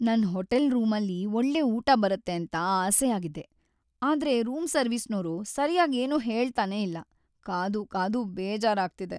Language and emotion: Kannada, sad